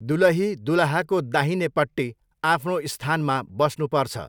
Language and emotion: Nepali, neutral